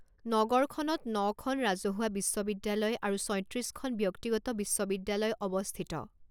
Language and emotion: Assamese, neutral